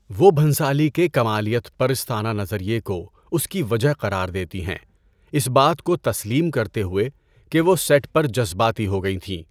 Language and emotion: Urdu, neutral